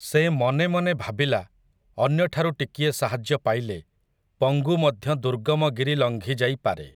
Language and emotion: Odia, neutral